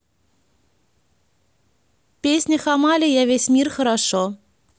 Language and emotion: Russian, neutral